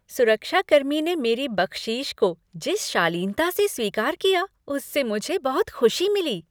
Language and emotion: Hindi, happy